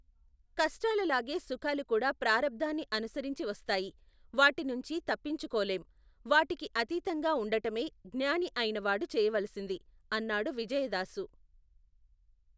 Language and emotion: Telugu, neutral